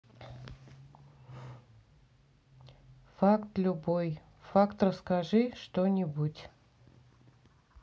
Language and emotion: Russian, neutral